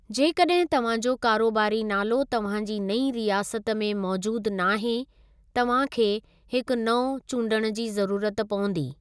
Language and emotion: Sindhi, neutral